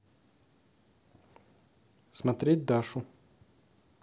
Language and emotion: Russian, neutral